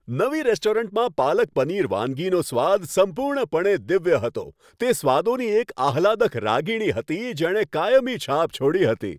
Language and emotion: Gujarati, happy